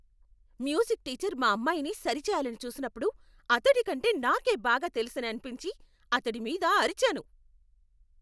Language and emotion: Telugu, angry